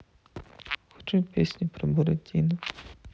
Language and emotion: Russian, sad